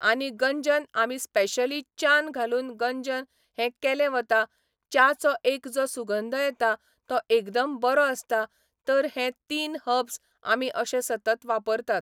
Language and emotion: Goan Konkani, neutral